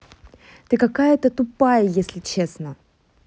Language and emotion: Russian, angry